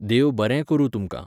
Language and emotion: Goan Konkani, neutral